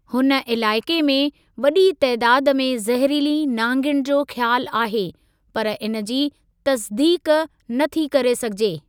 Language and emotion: Sindhi, neutral